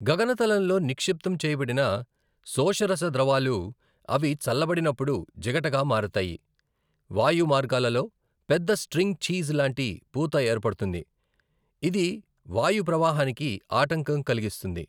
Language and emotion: Telugu, neutral